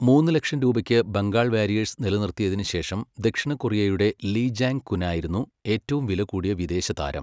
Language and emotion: Malayalam, neutral